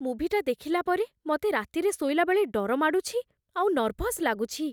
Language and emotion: Odia, fearful